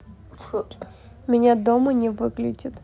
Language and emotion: Russian, neutral